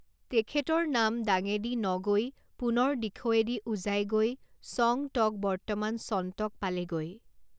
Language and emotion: Assamese, neutral